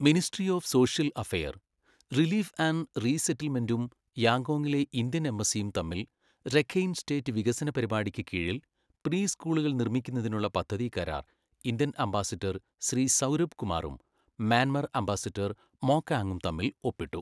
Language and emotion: Malayalam, neutral